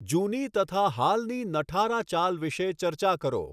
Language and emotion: Gujarati, neutral